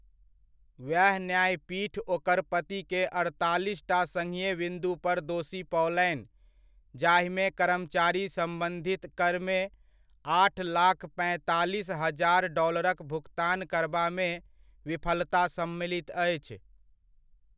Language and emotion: Maithili, neutral